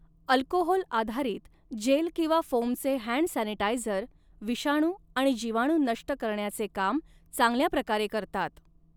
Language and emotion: Marathi, neutral